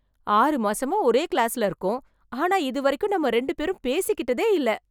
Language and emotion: Tamil, surprised